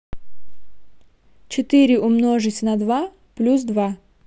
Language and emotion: Russian, neutral